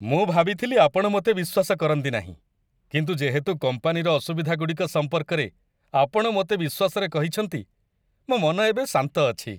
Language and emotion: Odia, happy